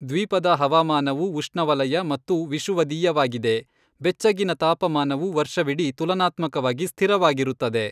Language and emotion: Kannada, neutral